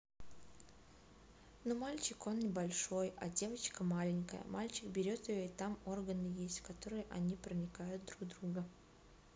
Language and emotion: Russian, neutral